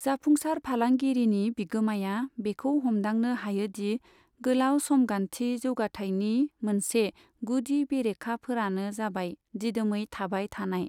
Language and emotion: Bodo, neutral